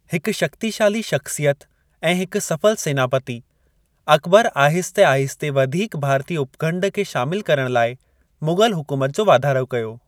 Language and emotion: Sindhi, neutral